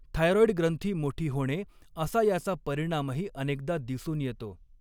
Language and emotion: Marathi, neutral